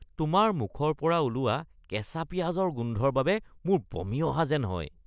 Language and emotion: Assamese, disgusted